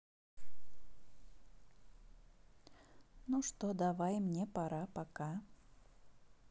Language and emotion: Russian, neutral